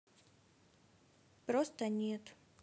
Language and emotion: Russian, sad